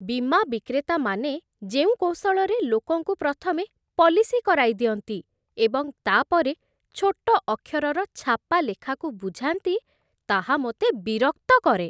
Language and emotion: Odia, disgusted